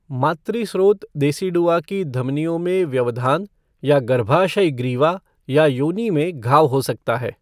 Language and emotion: Hindi, neutral